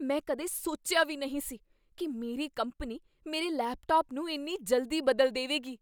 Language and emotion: Punjabi, surprised